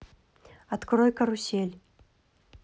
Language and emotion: Russian, neutral